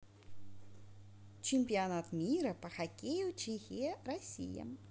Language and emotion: Russian, positive